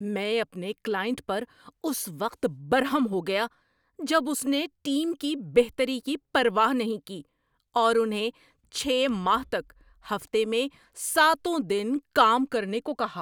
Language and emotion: Urdu, angry